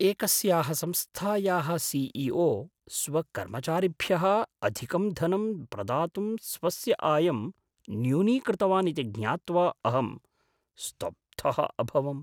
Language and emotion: Sanskrit, surprised